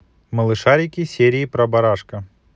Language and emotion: Russian, positive